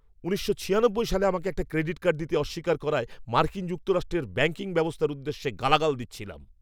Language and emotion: Bengali, angry